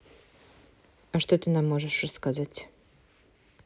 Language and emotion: Russian, neutral